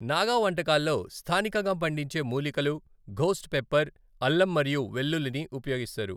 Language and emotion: Telugu, neutral